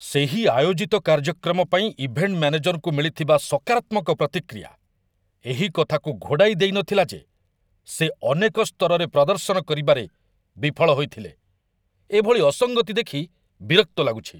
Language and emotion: Odia, angry